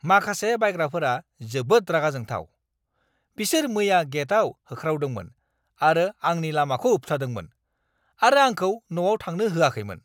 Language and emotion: Bodo, angry